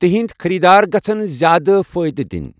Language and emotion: Kashmiri, neutral